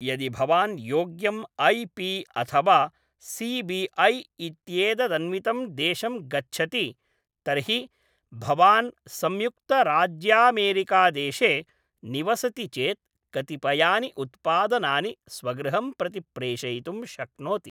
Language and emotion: Sanskrit, neutral